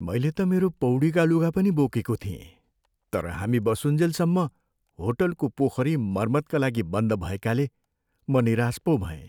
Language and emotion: Nepali, sad